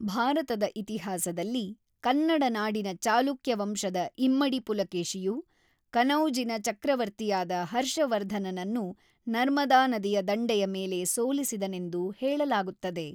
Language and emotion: Kannada, neutral